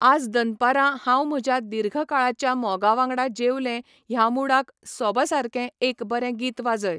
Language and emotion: Goan Konkani, neutral